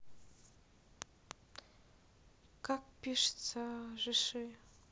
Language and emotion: Russian, neutral